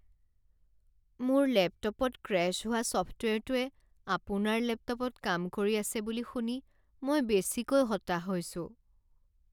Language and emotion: Assamese, sad